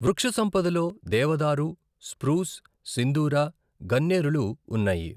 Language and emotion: Telugu, neutral